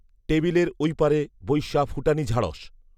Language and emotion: Bengali, neutral